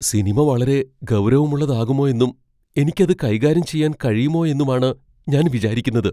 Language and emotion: Malayalam, fearful